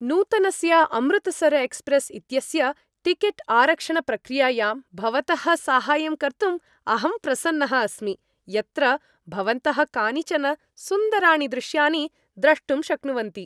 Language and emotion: Sanskrit, happy